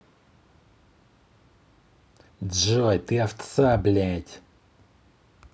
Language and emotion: Russian, angry